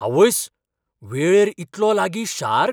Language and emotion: Goan Konkani, surprised